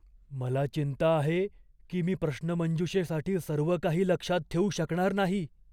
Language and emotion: Marathi, fearful